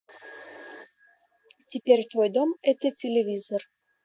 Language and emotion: Russian, neutral